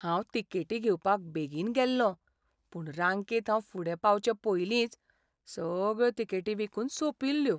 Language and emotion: Goan Konkani, sad